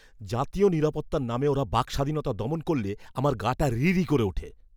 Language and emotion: Bengali, angry